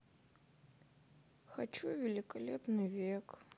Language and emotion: Russian, sad